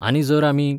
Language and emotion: Goan Konkani, neutral